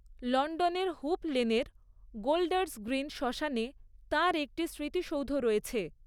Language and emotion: Bengali, neutral